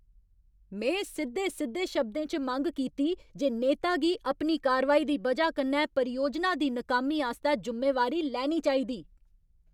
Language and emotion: Dogri, angry